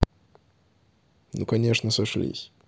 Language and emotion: Russian, neutral